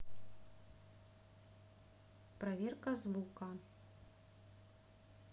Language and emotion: Russian, neutral